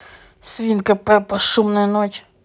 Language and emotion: Russian, angry